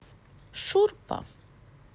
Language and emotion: Russian, neutral